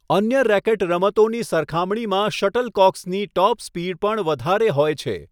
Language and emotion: Gujarati, neutral